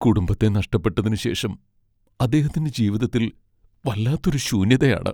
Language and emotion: Malayalam, sad